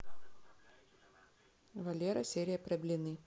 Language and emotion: Russian, neutral